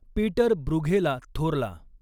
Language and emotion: Marathi, neutral